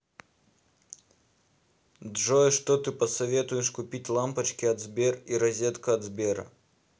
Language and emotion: Russian, neutral